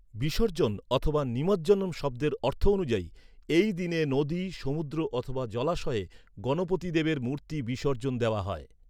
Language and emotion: Bengali, neutral